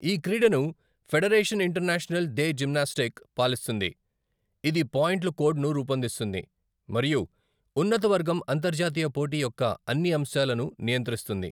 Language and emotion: Telugu, neutral